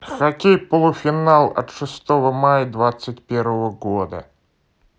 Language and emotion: Russian, neutral